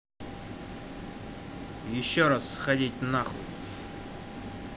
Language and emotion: Russian, angry